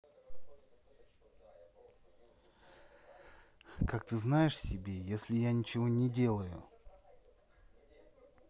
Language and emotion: Russian, neutral